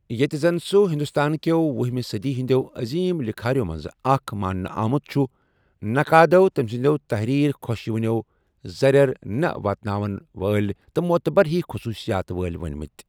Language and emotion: Kashmiri, neutral